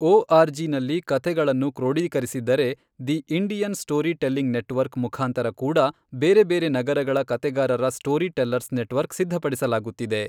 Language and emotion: Kannada, neutral